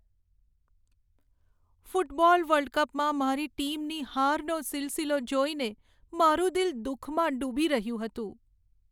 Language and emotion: Gujarati, sad